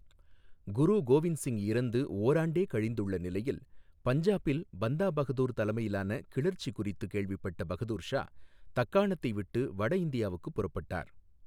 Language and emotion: Tamil, neutral